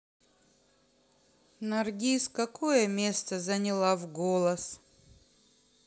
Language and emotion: Russian, sad